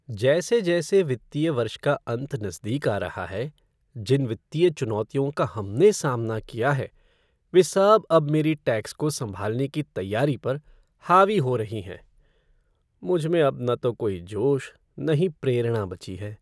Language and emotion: Hindi, sad